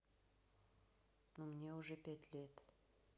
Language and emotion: Russian, neutral